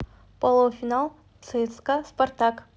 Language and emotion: Russian, neutral